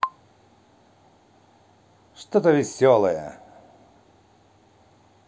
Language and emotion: Russian, positive